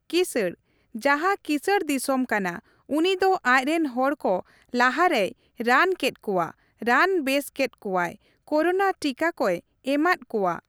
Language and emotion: Santali, neutral